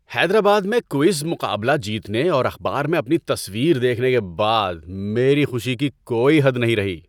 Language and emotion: Urdu, happy